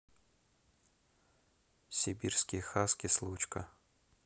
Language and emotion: Russian, neutral